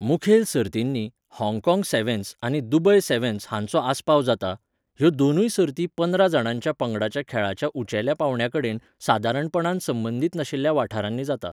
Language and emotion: Goan Konkani, neutral